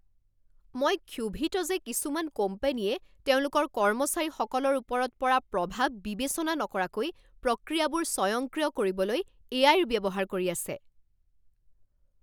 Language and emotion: Assamese, angry